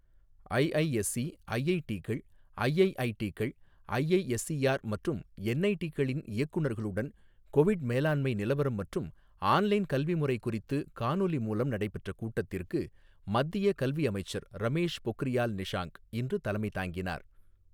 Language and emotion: Tamil, neutral